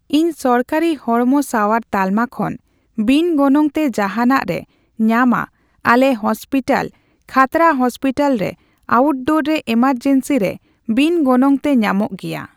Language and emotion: Santali, neutral